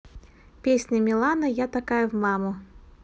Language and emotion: Russian, positive